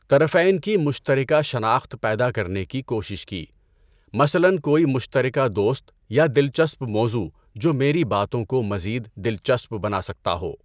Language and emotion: Urdu, neutral